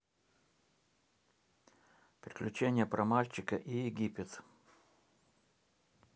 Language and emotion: Russian, neutral